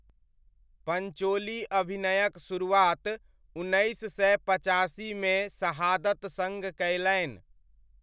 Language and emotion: Maithili, neutral